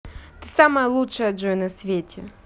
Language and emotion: Russian, positive